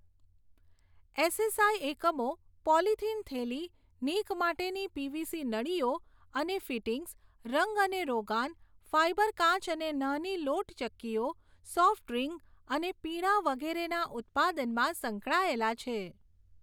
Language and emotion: Gujarati, neutral